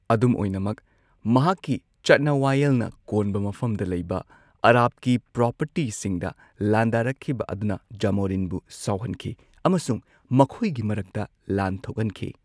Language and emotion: Manipuri, neutral